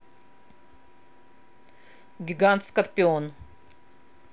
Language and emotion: Russian, neutral